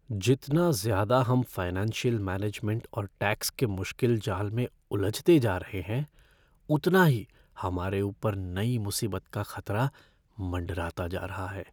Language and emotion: Hindi, fearful